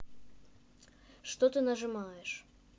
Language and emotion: Russian, neutral